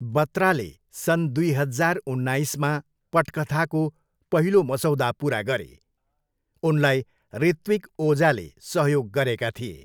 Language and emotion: Nepali, neutral